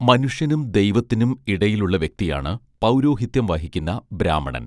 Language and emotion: Malayalam, neutral